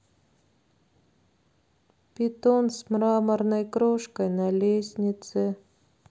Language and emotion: Russian, sad